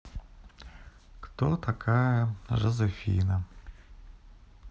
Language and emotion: Russian, sad